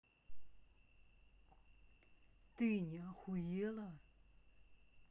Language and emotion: Russian, angry